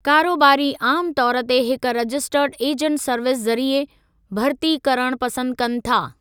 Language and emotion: Sindhi, neutral